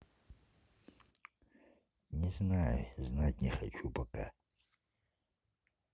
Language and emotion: Russian, neutral